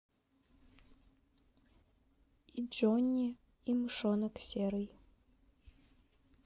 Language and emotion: Russian, neutral